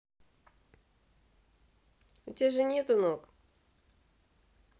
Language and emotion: Russian, neutral